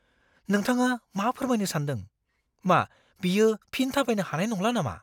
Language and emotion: Bodo, fearful